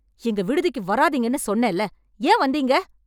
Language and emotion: Tamil, angry